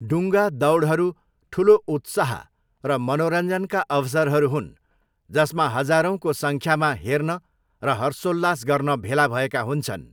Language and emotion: Nepali, neutral